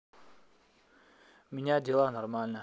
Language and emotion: Russian, neutral